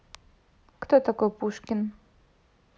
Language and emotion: Russian, neutral